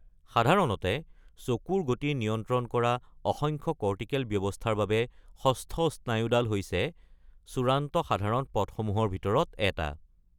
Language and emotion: Assamese, neutral